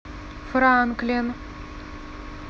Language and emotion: Russian, neutral